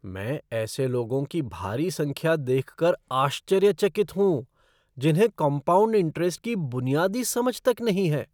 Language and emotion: Hindi, surprised